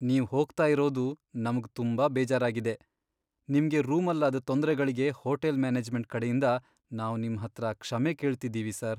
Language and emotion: Kannada, sad